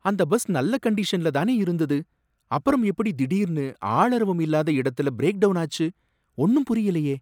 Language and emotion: Tamil, surprised